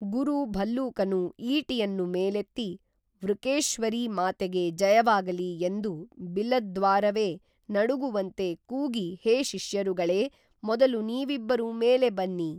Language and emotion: Kannada, neutral